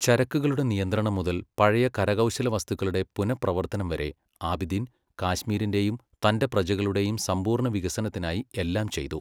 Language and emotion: Malayalam, neutral